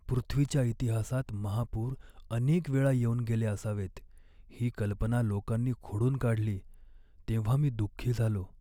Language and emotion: Marathi, sad